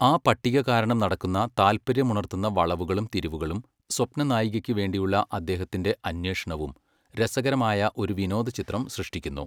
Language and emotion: Malayalam, neutral